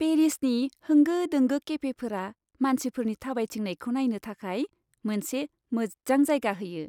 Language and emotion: Bodo, happy